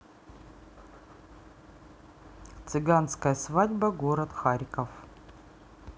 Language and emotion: Russian, neutral